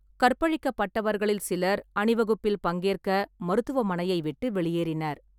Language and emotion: Tamil, neutral